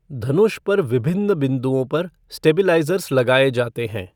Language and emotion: Hindi, neutral